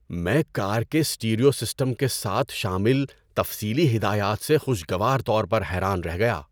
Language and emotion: Urdu, surprised